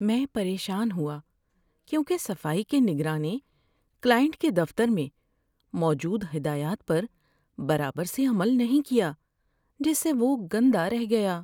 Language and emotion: Urdu, sad